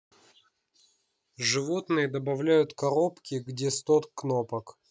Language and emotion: Russian, neutral